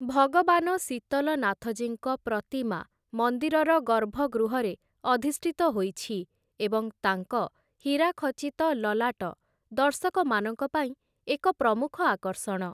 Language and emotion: Odia, neutral